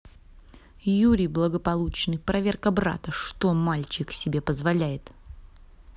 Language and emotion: Russian, angry